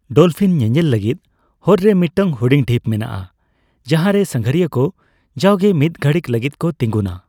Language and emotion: Santali, neutral